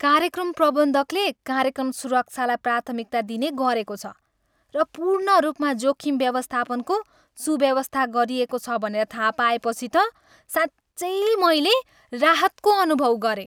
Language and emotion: Nepali, happy